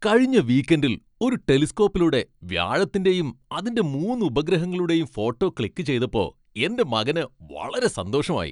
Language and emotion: Malayalam, happy